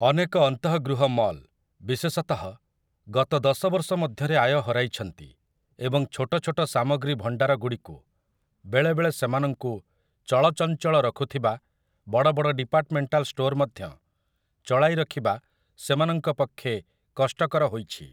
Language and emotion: Odia, neutral